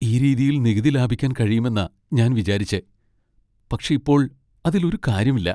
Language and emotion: Malayalam, sad